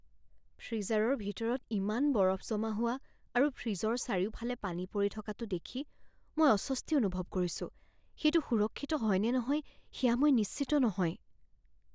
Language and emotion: Assamese, fearful